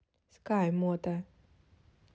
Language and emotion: Russian, neutral